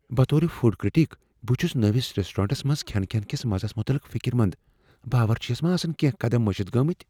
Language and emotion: Kashmiri, fearful